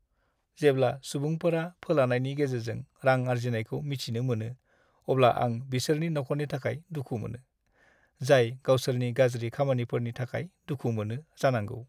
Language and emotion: Bodo, sad